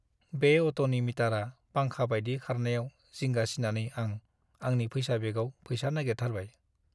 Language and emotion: Bodo, sad